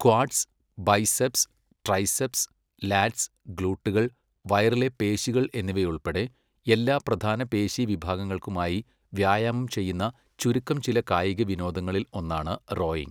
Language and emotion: Malayalam, neutral